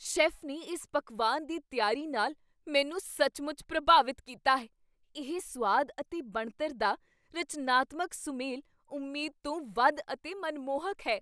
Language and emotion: Punjabi, surprised